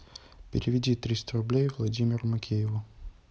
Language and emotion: Russian, neutral